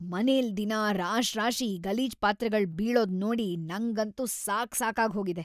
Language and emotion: Kannada, disgusted